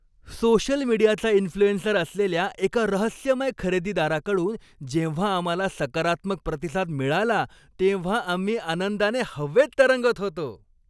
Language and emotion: Marathi, happy